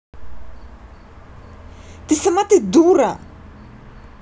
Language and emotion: Russian, angry